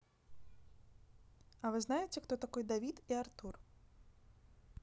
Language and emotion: Russian, neutral